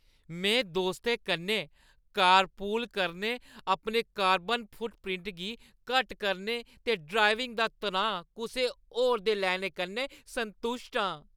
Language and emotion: Dogri, happy